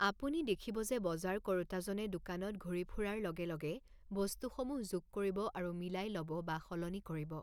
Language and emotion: Assamese, neutral